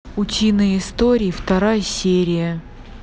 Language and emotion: Russian, neutral